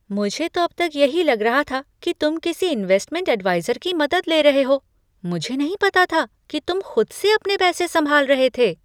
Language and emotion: Hindi, surprised